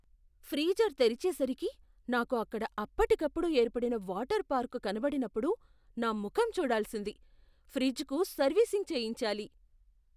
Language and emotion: Telugu, surprised